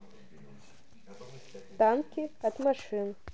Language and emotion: Russian, neutral